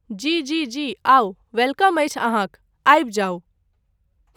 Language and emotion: Maithili, neutral